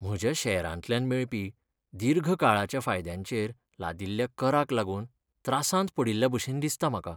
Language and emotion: Goan Konkani, sad